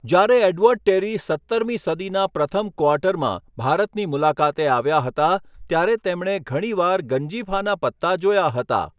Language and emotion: Gujarati, neutral